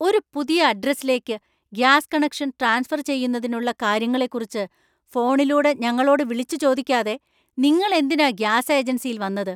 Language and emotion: Malayalam, angry